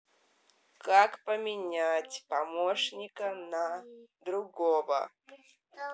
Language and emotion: Russian, angry